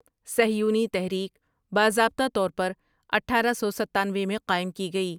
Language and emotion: Urdu, neutral